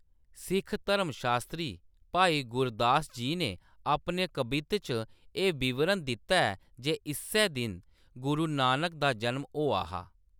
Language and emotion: Dogri, neutral